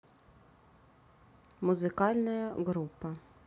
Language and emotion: Russian, neutral